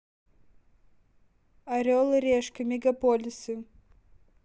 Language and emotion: Russian, neutral